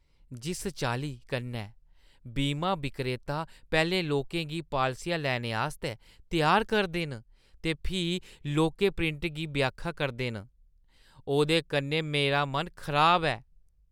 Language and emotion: Dogri, disgusted